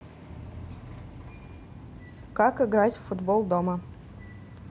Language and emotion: Russian, neutral